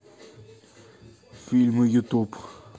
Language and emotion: Russian, neutral